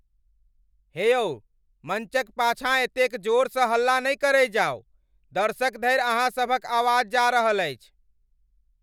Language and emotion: Maithili, angry